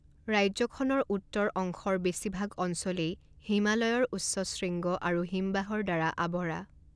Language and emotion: Assamese, neutral